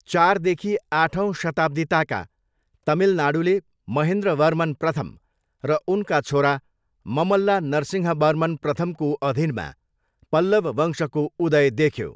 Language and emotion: Nepali, neutral